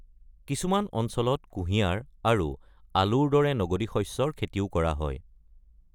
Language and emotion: Assamese, neutral